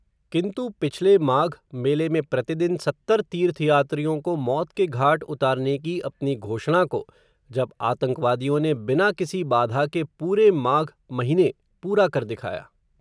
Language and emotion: Hindi, neutral